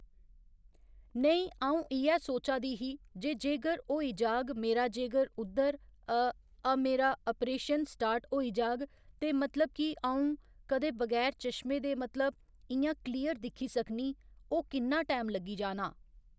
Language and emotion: Dogri, neutral